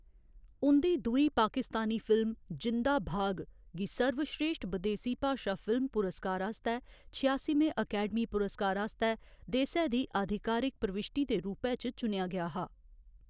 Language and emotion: Dogri, neutral